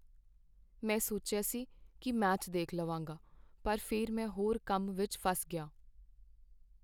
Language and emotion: Punjabi, sad